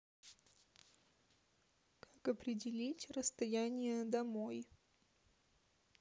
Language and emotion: Russian, neutral